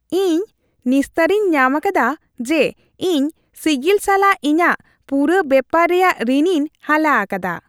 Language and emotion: Santali, happy